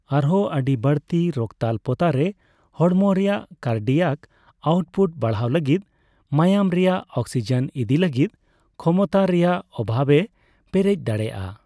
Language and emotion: Santali, neutral